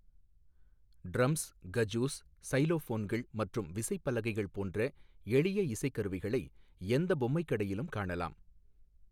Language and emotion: Tamil, neutral